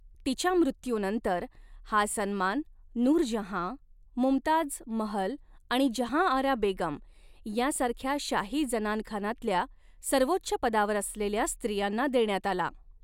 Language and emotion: Marathi, neutral